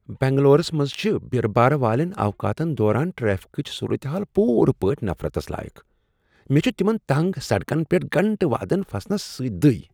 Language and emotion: Kashmiri, disgusted